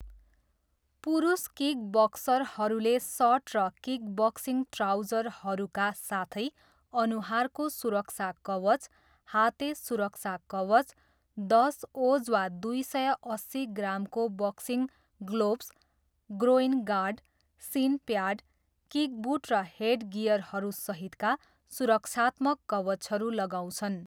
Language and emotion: Nepali, neutral